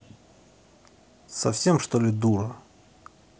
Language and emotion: Russian, angry